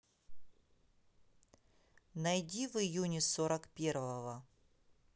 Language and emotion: Russian, neutral